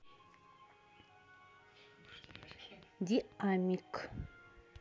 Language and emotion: Russian, neutral